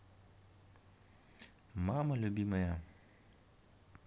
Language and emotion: Russian, neutral